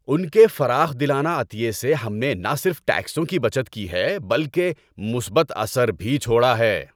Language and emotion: Urdu, happy